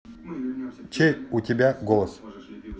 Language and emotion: Russian, neutral